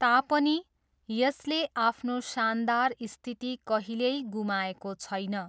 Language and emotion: Nepali, neutral